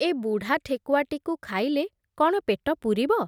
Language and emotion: Odia, neutral